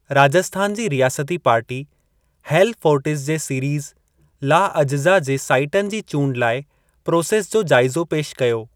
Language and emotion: Sindhi, neutral